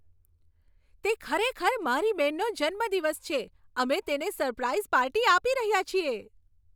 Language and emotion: Gujarati, happy